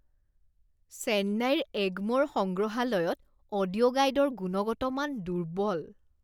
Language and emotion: Assamese, disgusted